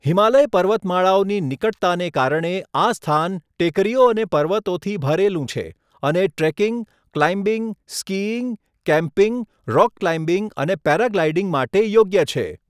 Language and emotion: Gujarati, neutral